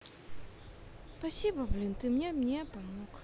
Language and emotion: Russian, sad